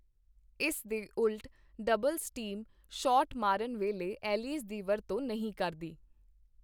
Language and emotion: Punjabi, neutral